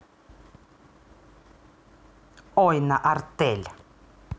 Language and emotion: Russian, angry